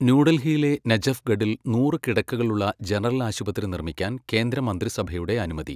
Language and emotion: Malayalam, neutral